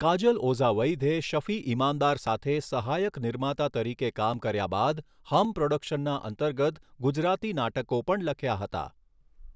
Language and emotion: Gujarati, neutral